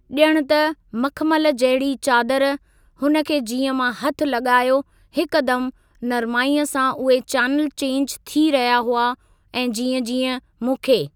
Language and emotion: Sindhi, neutral